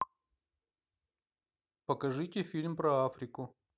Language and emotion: Russian, neutral